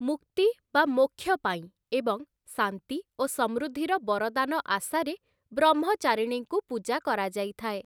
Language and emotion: Odia, neutral